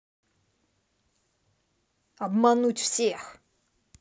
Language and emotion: Russian, angry